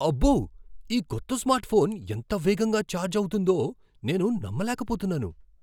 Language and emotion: Telugu, surprised